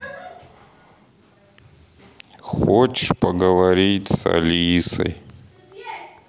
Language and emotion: Russian, sad